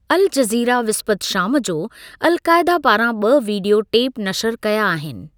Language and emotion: Sindhi, neutral